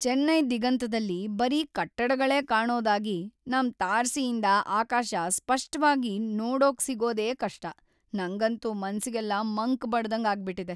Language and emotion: Kannada, sad